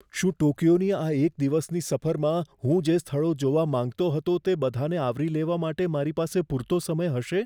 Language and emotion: Gujarati, fearful